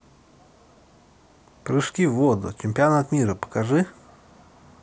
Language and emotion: Russian, neutral